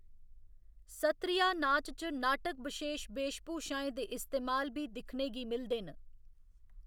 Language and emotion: Dogri, neutral